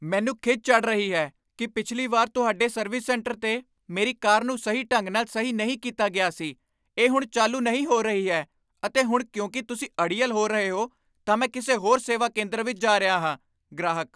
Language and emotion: Punjabi, angry